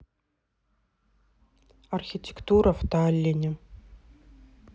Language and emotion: Russian, neutral